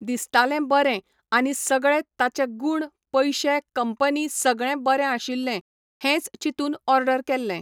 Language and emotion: Goan Konkani, neutral